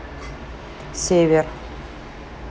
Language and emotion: Russian, neutral